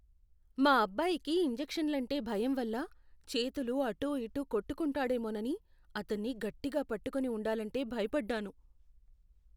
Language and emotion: Telugu, fearful